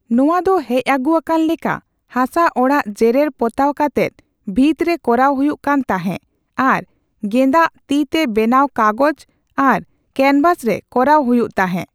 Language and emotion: Santali, neutral